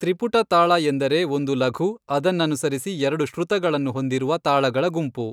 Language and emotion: Kannada, neutral